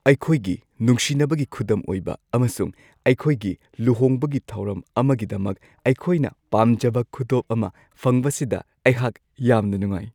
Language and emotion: Manipuri, happy